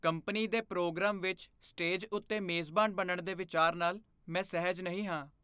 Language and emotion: Punjabi, fearful